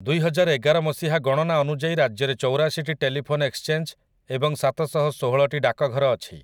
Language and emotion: Odia, neutral